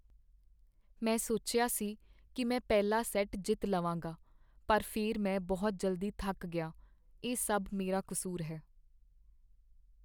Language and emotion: Punjabi, sad